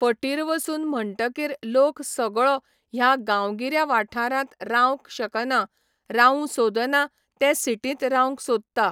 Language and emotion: Goan Konkani, neutral